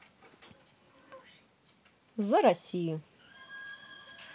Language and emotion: Russian, positive